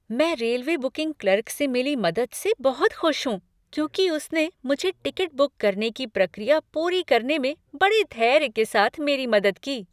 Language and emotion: Hindi, happy